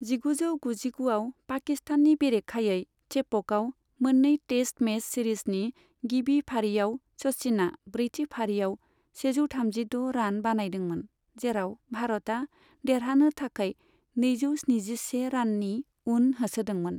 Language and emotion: Bodo, neutral